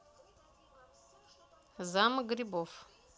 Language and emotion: Russian, neutral